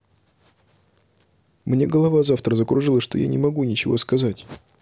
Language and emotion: Russian, neutral